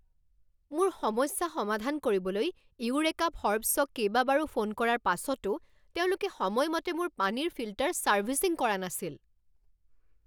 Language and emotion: Assamese, angry